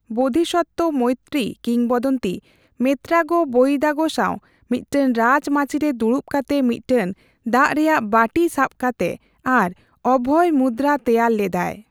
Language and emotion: Santali, neutral